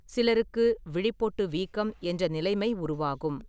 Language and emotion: Tamil, neutral